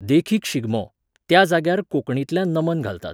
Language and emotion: Goan Konkani, neutral